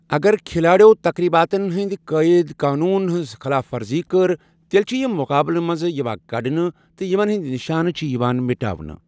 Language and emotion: Kashmiri, neutral